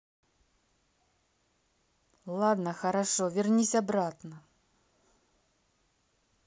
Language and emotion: Russian, neutral